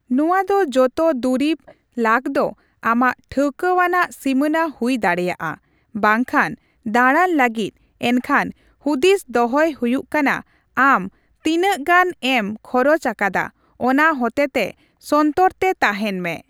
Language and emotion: Santali, neutral